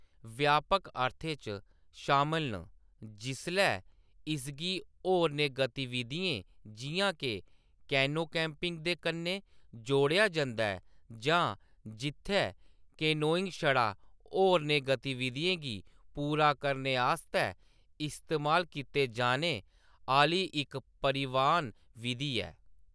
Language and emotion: Dogri, neutral